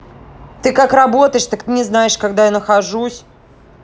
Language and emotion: Russian, angry